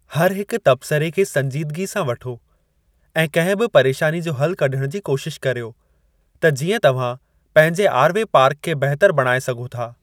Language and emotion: Sindhi, neutral